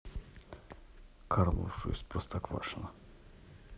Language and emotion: Russian, neutral